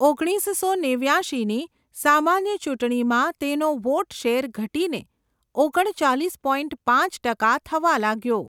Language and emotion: Gujarati, neutral